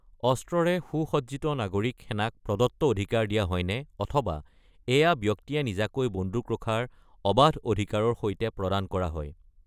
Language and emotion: Assamese, neutral